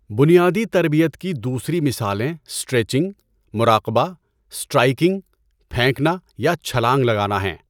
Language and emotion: Urdu, neutral